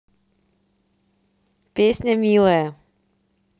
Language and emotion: Russian, positive